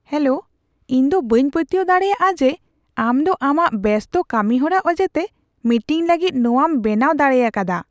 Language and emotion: Santali, surprised